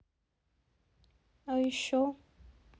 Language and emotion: Russian, neutral